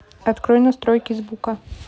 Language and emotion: Russian, neutral